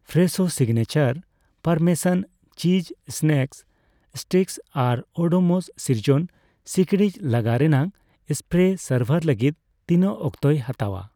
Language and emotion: Santali, neutral